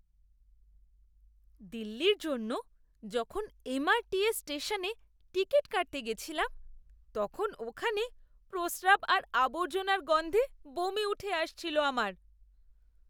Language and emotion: Bengali, disgusted